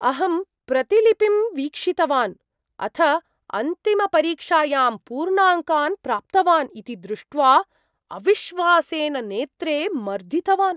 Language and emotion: Sanskrit, surprised